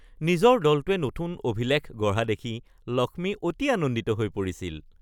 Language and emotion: Assamese, happy